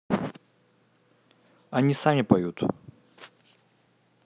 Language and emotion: Russian, neutral